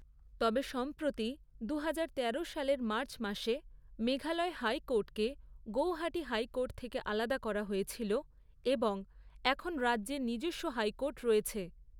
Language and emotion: Bengali, neutral